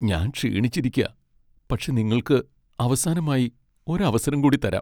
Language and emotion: Malayalam, sad